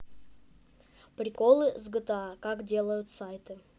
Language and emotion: Russian, neutral